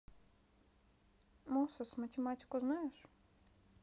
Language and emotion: Russian, neutral